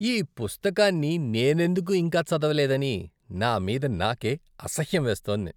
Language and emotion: Telugu, disgusted